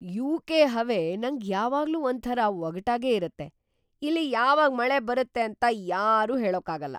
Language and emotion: Kannada, surprised